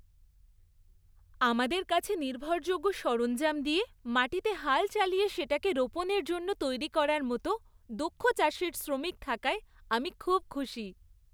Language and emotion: Bengali, happy